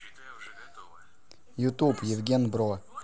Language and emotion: Russian, neutral